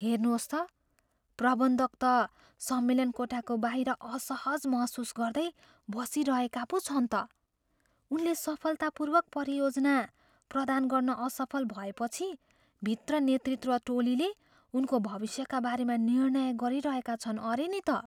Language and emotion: Nepali, fearful